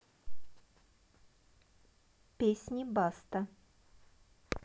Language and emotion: Russian, neutral